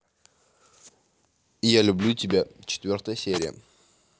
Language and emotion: Russian, neutral